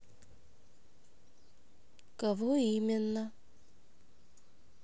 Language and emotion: Russian, neutral